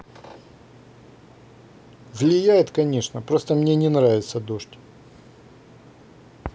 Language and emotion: Russian, neutral